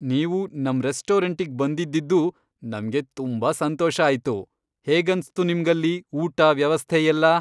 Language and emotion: Kannada, happy